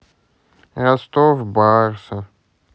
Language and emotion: Russian, sad